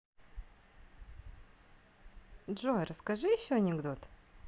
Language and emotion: Russian, positive